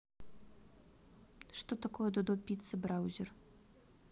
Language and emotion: Russian, neutral